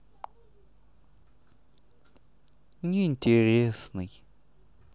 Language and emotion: Russian, sad